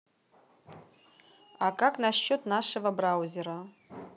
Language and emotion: Russian, neutral